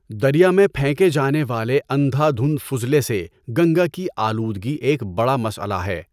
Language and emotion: Urdu, neutral